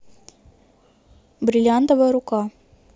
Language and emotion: Russian, neutral